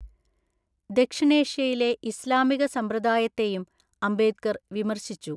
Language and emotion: Malayalam, neutral